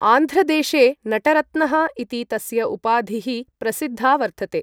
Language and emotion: Sanskrit, neutral